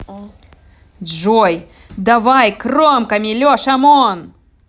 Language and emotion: Russian, angry